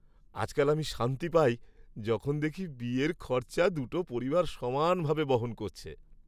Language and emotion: Bengali, happy